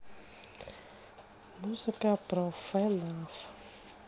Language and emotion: Russian, neutral